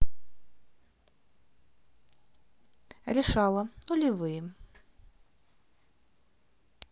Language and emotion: Russian, neutral